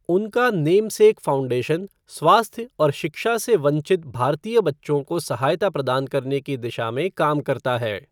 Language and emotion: Hindi, neutral